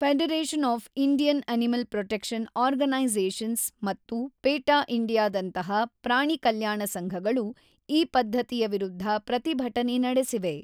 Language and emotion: Kannada, neutral